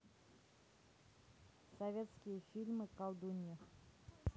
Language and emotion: Russian, neutral